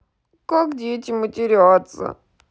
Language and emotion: Russian, sad